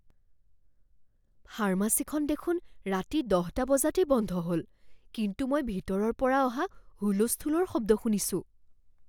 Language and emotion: Assamese, fearful